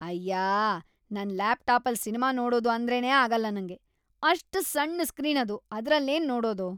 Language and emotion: Kannada, disgusted